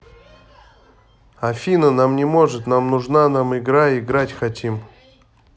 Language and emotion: Russian, angry